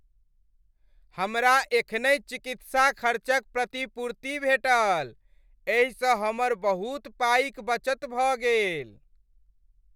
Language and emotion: Maithili, happy